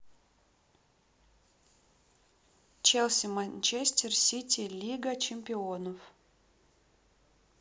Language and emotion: Russian, neutral